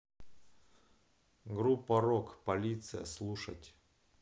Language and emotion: Russian, neutral